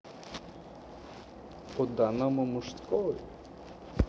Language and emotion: Russian, neutral